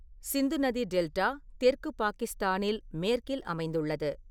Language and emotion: Tamil, neutral